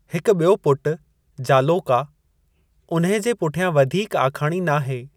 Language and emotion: Sindhi, neutral